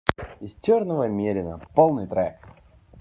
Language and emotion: Russian, positive